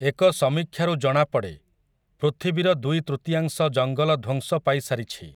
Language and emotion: Odia, neutral